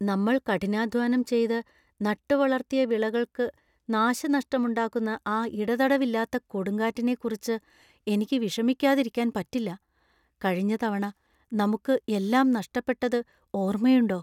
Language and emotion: Malayalam, fearful